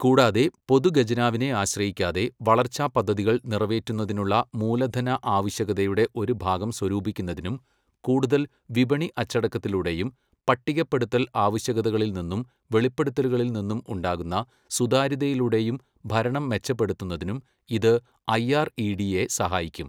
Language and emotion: Malayalam, neutral